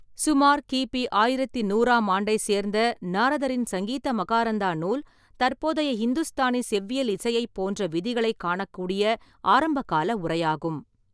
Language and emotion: Tamil, neutral